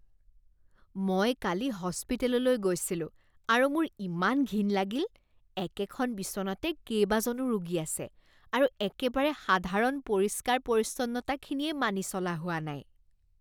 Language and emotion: Assamese, disgusted